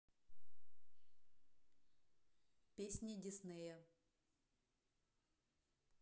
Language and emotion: Russian, neutral